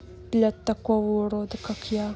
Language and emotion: Russian, neutral